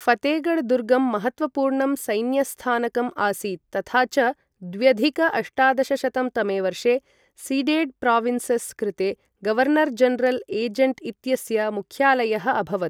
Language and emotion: Sanskrit, neutral